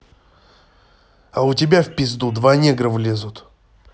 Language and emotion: Russian, angry